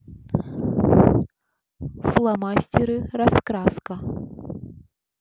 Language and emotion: Russian, neutral